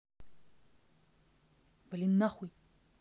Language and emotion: Russian, angry